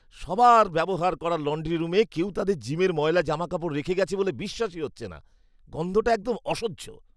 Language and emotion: Bengali, disgusted